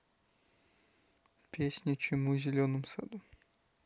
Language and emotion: Russian, neutral